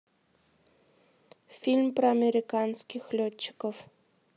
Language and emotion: Russian, neutral